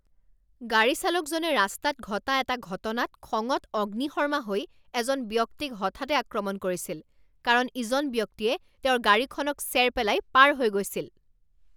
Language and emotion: Assamese, angry